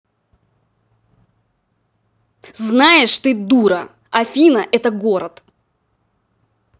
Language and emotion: Russian, angry